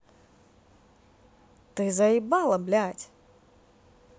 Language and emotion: Russian, angry